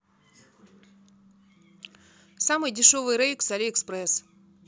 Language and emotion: Russian, neutral